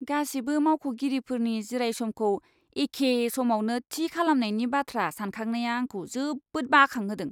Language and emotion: Bodo, disgusted